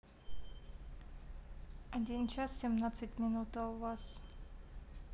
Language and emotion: Russian, neutral